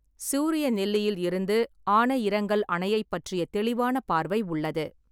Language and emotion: Tamil, neutral